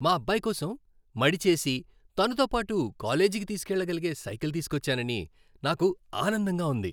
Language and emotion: Telugu, happy